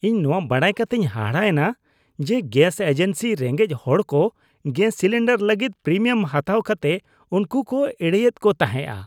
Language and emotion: Santali, disgusted